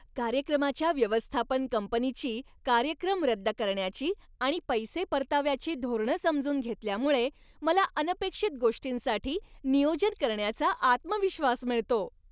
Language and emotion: Marathi, happy